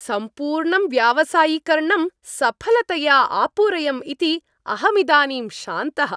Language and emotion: Sanskrit, happy